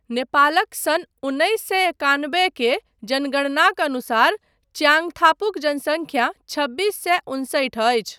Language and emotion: Maithili, neutral